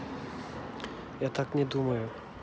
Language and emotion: Russian, neutral